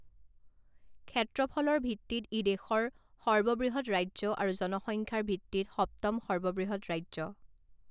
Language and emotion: Assamese, neutral